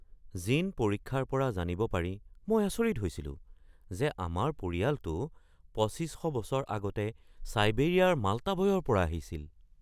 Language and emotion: Assamese, surprised